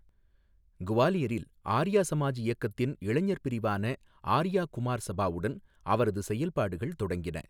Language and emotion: Tamil, neutral